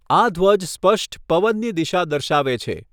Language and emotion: Gujarati, neutral